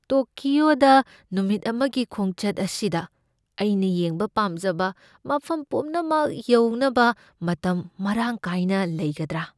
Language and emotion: Manipuri, fearful